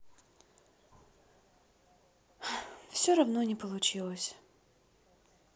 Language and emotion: Russian, sad